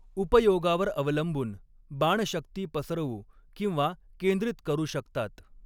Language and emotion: Marathi, neutral